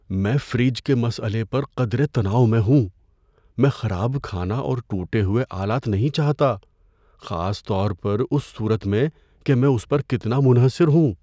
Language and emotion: Urdu, fearful